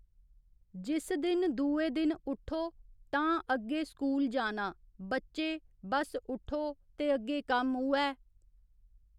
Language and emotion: Dogri, neutral